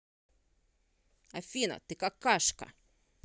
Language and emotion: Russian, angry